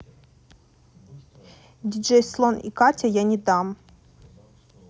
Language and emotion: Russian, neutral